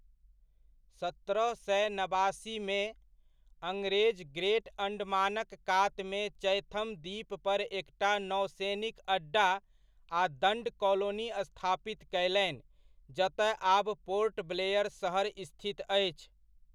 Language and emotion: Maithili, neutral